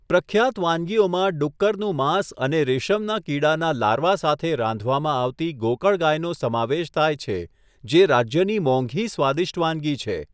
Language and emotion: Gujarati, neutral